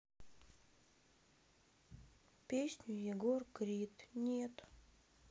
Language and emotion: Russian, sad